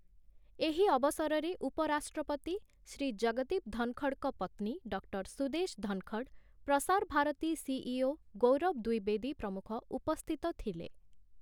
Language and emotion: Odia, neutral